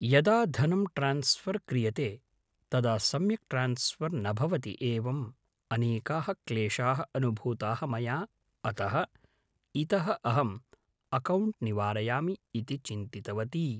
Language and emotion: Sanskrit, neutral